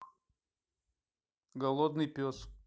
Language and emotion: Russian, neutral